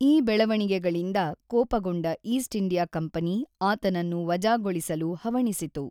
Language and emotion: Kannada, neutral